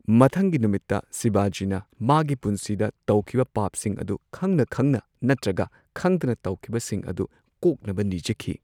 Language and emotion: Manipuri, neutral